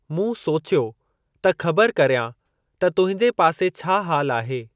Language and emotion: Sindhi, neutral